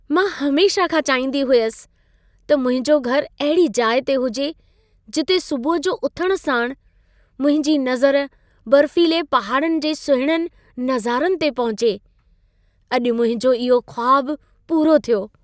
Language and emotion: Sindhi, happy